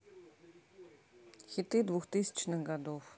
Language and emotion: Russian, neutral